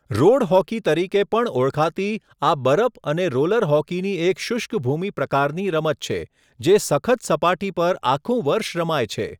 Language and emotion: Gujarati, neutral